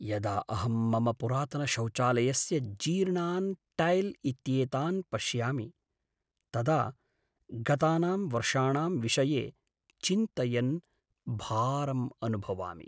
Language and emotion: Sanskrit, sad